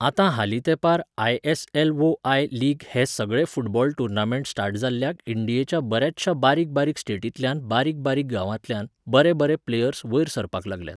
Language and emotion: Goan Konkani, neutral